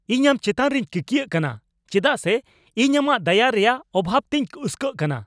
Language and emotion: Santali, angry